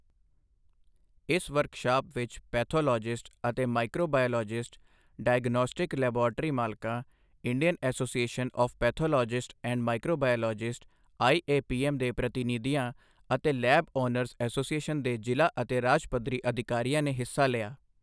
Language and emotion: Punjabi, neutral